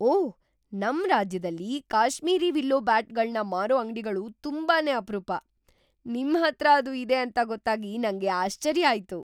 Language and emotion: Kannada, surprised